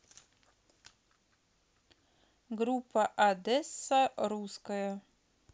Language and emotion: Russian, neutral